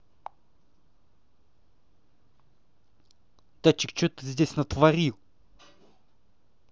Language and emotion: Russian, angry